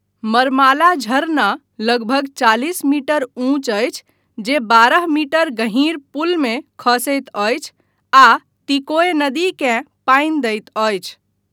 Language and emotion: Maithili, neutral